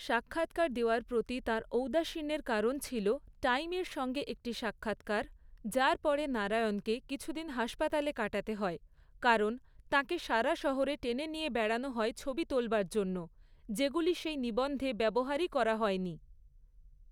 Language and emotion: Bengali, neutral